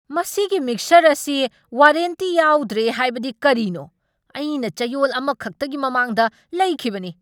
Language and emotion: Manipuri, angry